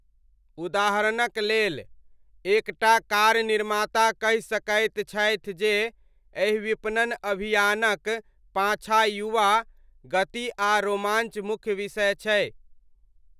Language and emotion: Maithili, neutral